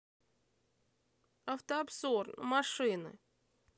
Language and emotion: Russian, neutral